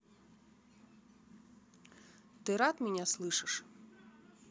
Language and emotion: Russian, neutral